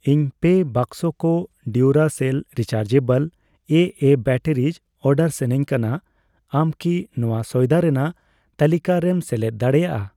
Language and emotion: Santali, neutral